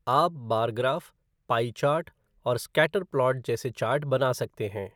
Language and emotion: Hindi, neutral